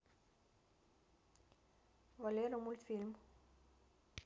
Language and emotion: Russian, neutral